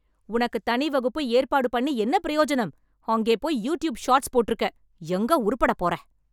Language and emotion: Tamil, angry